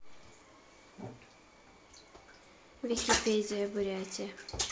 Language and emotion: Russian, neutral